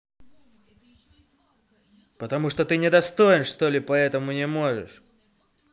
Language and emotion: Russian, angry